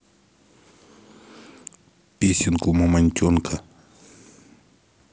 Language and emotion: Russian, neutral